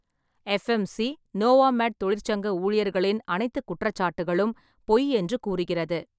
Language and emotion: Tamil, neutral